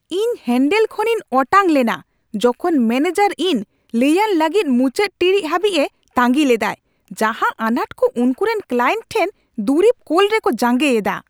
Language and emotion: Santali, angry